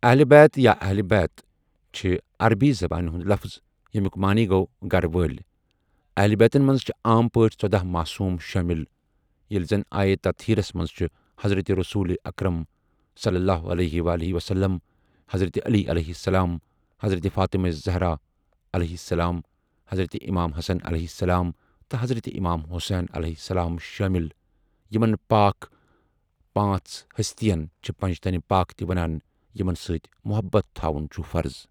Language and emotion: Kashmiri, neutral